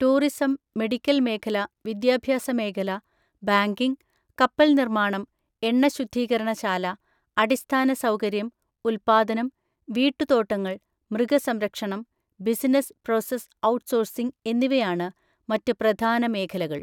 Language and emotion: Malayalam, neutral